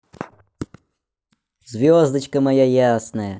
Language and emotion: Russian, positive